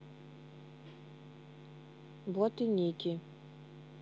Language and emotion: Russian, neutral